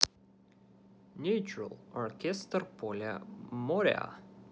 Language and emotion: Russian, neutral